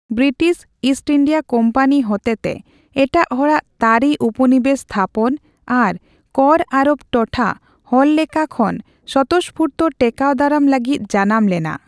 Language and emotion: Santali, neutral